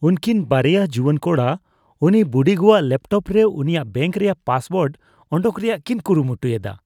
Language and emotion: Santali, disgusted